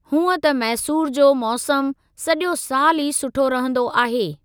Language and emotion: Sindhi, neutral